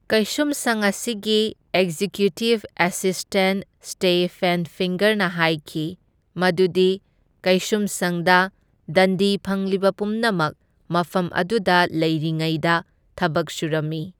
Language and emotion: Manipuri, neutral